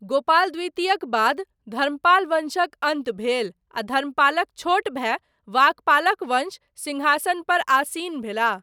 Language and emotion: Maithili, neutral